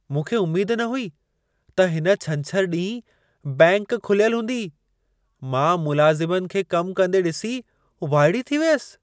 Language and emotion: Sindhi, surprised